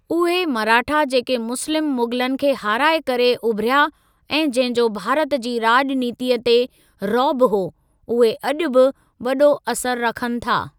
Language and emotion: Sindhi, neutral